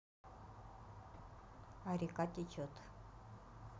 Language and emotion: Russian, neutral